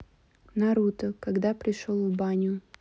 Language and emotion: Russian, neutral